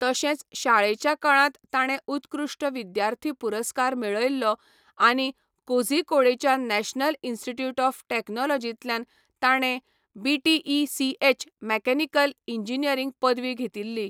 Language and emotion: Goan Konkani, neutral